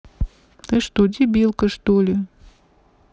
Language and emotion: Russian, neutral